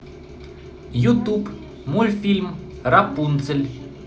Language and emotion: Russian, positive